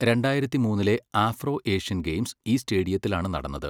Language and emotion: Malayalam, neutral